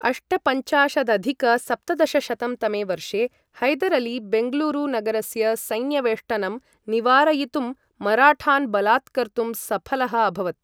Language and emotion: Sanskrit, neutral